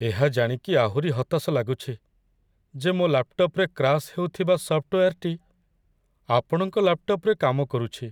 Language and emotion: Odia, sad